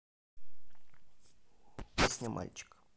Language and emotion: Russian, neutral